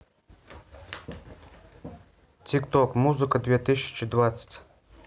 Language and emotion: Russian, neutral